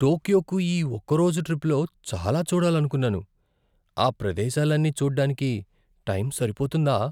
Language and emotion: Telugu, fearful